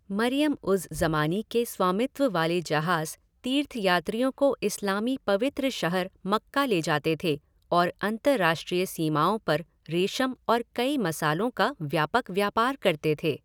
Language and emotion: Hindi, neutral